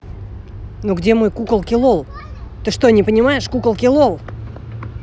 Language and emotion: Russian, angry